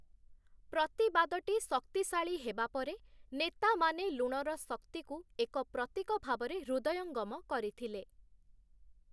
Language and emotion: Odia, neutral